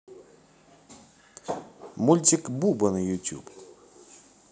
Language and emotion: Russian, positive